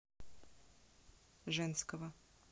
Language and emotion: Russian, neutral